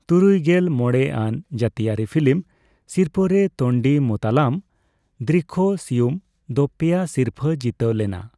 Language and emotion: Santali, neutral